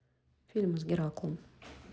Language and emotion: Russian, neutral